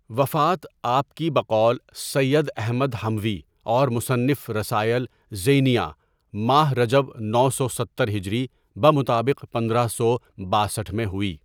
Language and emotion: Urdu, neutral